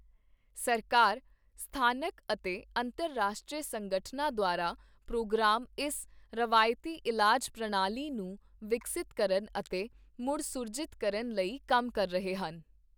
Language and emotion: Punjabi, neutral